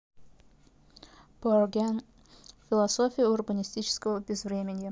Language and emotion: Russian, neutral